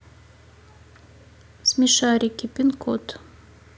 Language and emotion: Russian, neutral